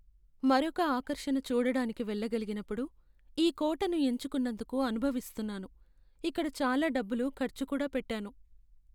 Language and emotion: Telugu, sad